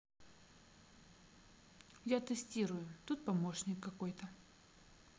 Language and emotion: Russian, neutral